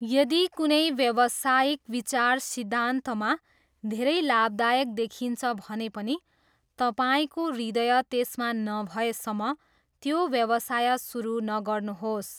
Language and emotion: Nepali, neutral